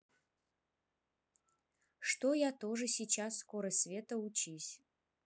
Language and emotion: Russian, neutral